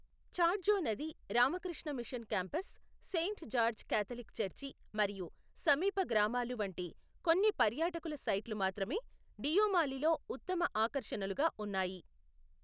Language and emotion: Telugu, neutral